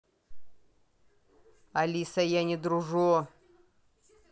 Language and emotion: Russian, angry